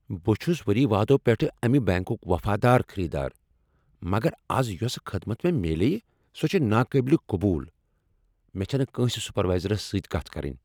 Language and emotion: Kashmiri, angry